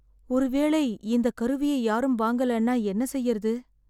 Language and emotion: Tamil, sad